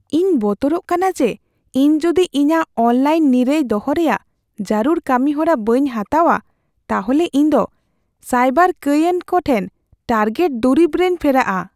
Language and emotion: Santali, fearful